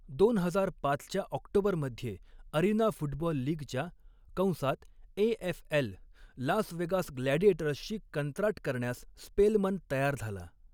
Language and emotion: Marathi, neutral